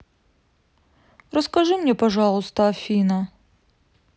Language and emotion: Russian, sad